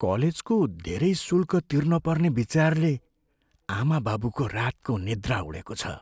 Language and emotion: Nepali, fearful